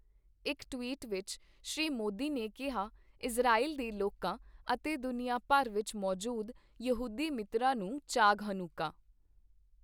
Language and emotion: Punjabi, neutral